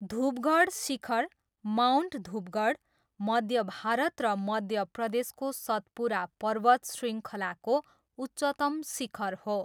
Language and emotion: Nepali, neutral